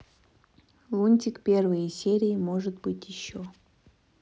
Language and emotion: Russian, neutral